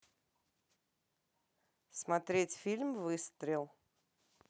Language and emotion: Russian, neutral